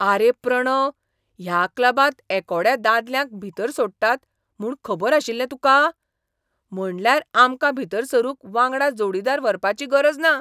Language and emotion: Goan Konkani, surprised